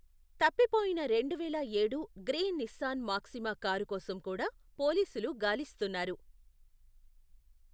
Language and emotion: Telugu, neutral